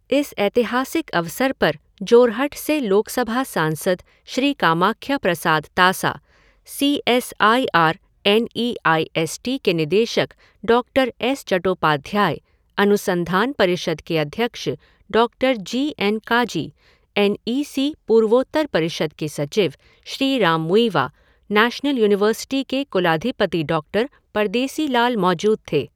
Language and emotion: Hindi, neutral